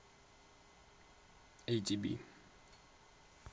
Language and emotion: Russian, neutral